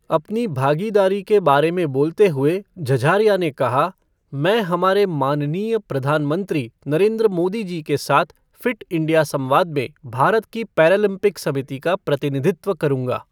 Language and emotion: Hindi, neutral